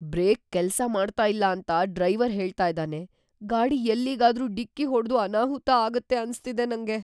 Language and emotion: Kannada, fearful